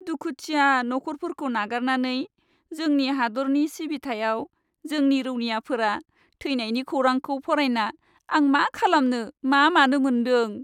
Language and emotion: Bodo, sad